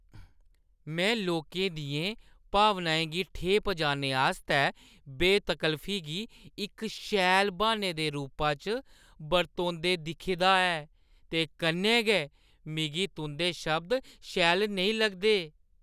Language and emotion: Dogri, disgusted